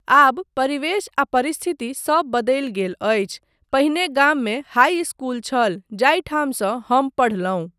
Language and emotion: Maithili, neutral